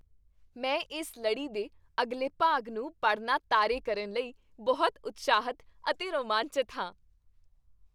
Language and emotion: Punjabi, happy